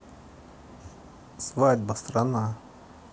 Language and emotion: Russian, neutral